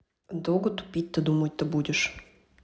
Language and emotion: Russian, neutral